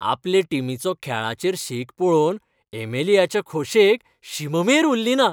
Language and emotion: Goan Konkani, happy